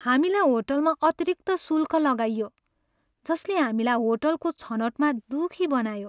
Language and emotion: Nepali, sad